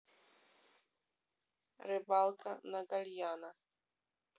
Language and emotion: Russian, neutral